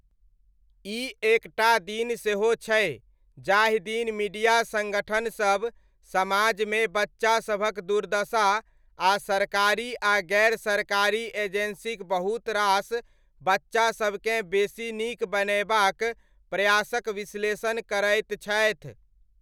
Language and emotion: Maithili, neutral